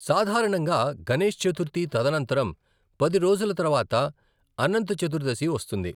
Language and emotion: Telugu, neutral